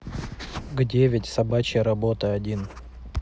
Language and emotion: Russian, neutral